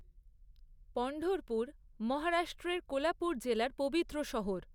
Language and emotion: Bengali, neutral